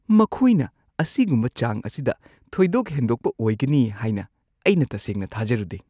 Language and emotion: Manipuri, surprised